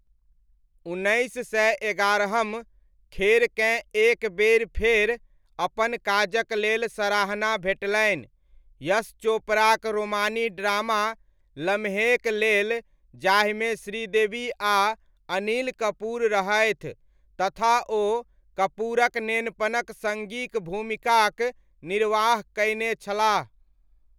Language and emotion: Maithili, neutral